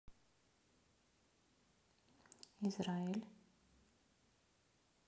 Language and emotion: Russian, neutral